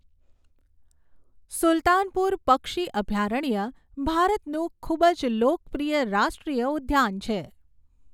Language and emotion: Gujarati, neutral